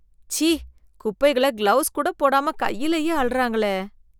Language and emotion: Tamil, disgusted